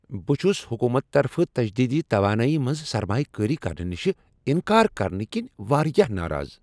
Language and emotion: Kashmiri, angry